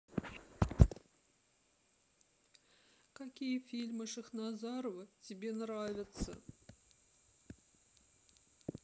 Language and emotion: Russian, sad